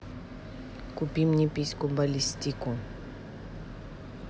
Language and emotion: Russian, neutral